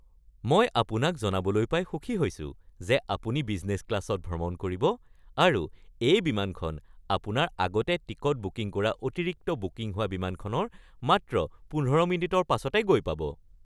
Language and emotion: Assamese, happy